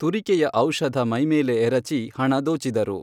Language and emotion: Kannada, neutral